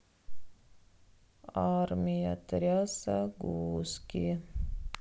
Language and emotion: Russian, sad